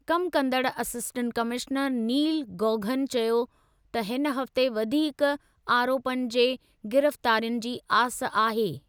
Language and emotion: Sindhi, neutral